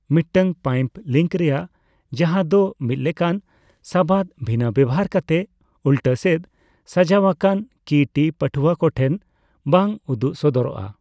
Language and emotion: Santali, neutral